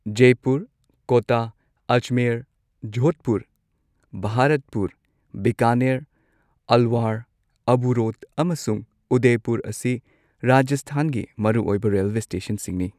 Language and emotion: Manipuri, neutral